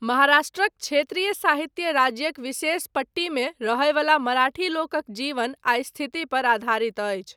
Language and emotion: Maithili, neutral